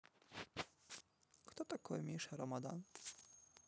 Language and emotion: Russian, neutral